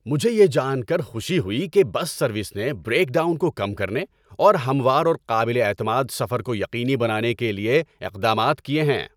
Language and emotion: Urdu, happy